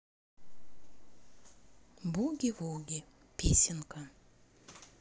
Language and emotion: Russian, neutral